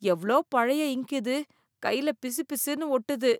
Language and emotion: Tamil, disgusted